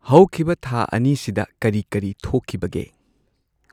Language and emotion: Manipuri, neutral